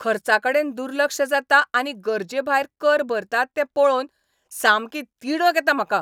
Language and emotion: Goan Konkani, angry